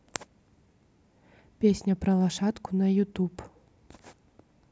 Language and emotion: Russian, neutral